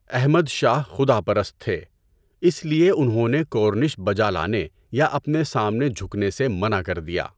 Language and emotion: Urdu, neutral